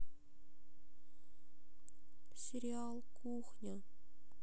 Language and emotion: Russian, sad